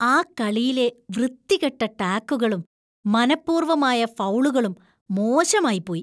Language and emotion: Malayalam, disgusted